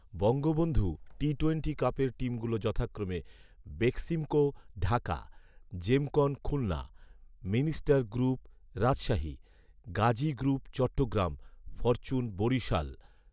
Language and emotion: Bengali, neutral